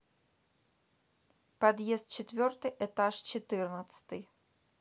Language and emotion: Russian, neutral